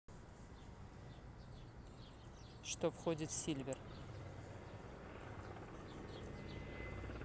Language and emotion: Russian, neutral